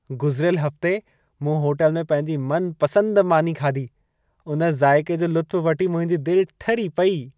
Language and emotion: Sindhi, happy